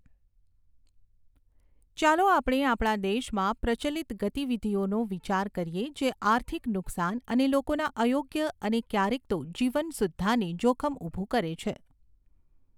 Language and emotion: Gujarati, neutral